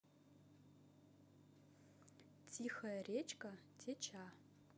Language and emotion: Russian, neutral